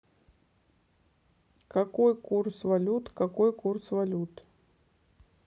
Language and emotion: Russian, neutral